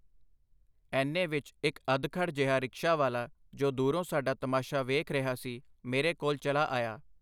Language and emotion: Punjabi, neutral